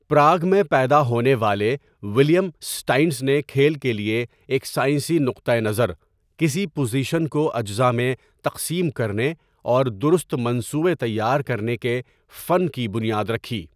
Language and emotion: Urdu, neutral